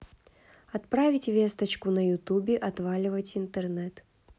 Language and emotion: Russian, neutral